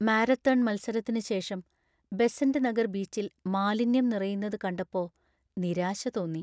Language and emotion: Malayalam, sad